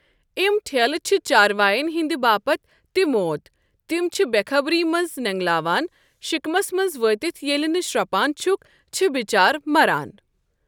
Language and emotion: Kashmiri, neutral